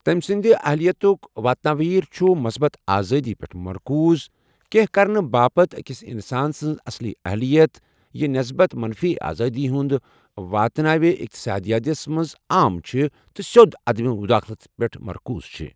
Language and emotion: Kashmiri, neutral